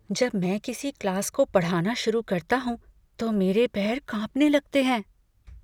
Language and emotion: Hindi, fearful